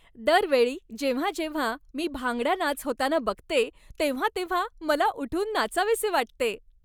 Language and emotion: Marathi, happy